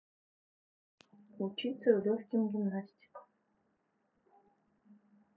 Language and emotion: Russian, neutral